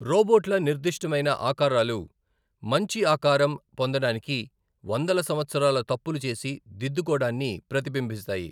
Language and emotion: Telugu, neutral